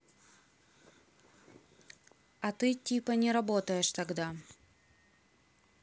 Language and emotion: Russian, neutral